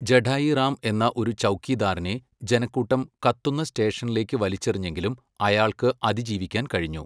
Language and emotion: Malayalam, neutral